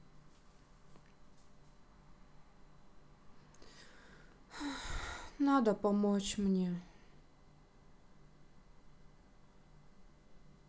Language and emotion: Russian, sad